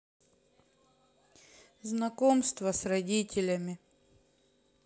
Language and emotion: Russian, neutral